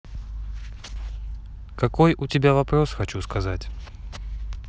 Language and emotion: Russian, neutral